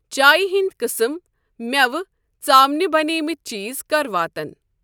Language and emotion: Kashmiri, neutral